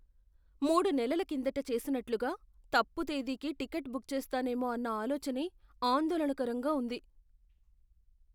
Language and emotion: Telugu, fearful